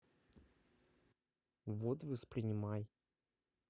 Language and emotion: Russian, neutral